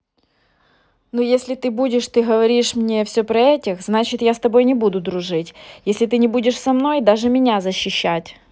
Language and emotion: Russian, angry